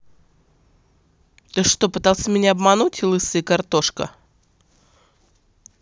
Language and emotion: Russian, angry